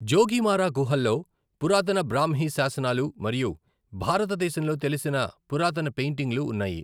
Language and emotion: Telugu, neutral